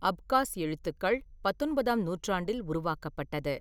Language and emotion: Tamil, neutral